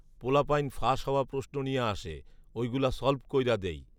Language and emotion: Bengali, neutral